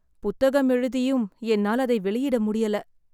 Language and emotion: Tamil, sad